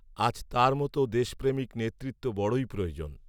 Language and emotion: Bengali, neutral